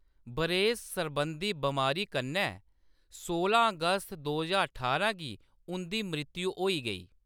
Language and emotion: Dogri, neutral